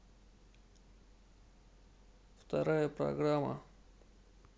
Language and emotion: Russian, neutral